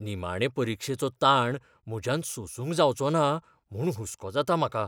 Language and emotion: Goan Konkani, fearful